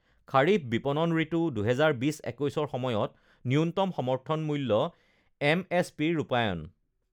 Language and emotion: Assamese, neutral